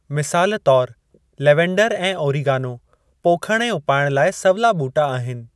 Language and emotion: Sindhi, neutral